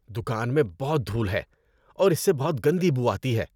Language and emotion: Urdu, disgusted